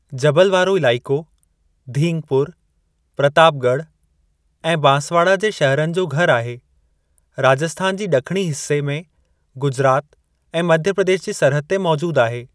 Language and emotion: Sindhi, neutral